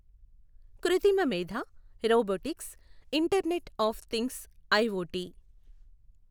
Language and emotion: Telugu, neutral